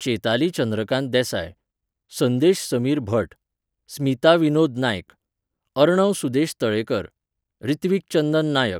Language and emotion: Goan Konkani, neutral